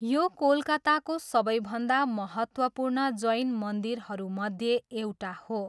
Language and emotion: Nepali, neutral